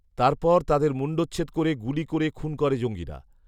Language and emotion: Bengali, neutral